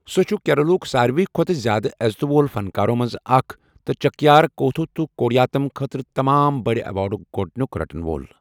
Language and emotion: Kashmiri, neutral